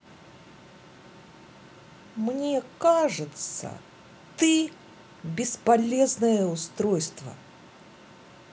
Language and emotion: Russian, angry